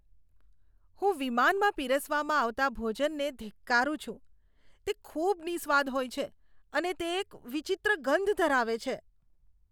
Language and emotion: Gujarati, disgusted